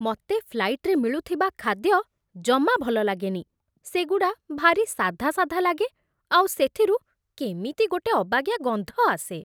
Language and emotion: Odia, disgusted